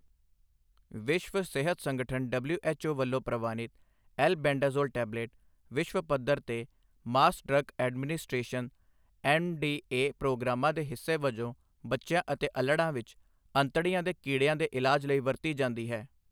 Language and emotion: Punjabi, neutral